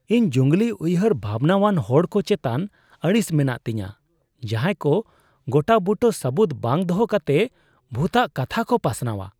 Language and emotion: Santali, disgusted